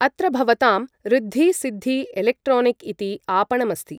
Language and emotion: Sanskrit, neutral